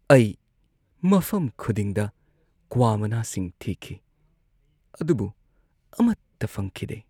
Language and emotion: Manipuri, sad